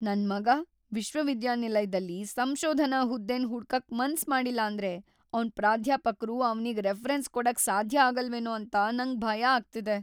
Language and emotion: Kannada, fearful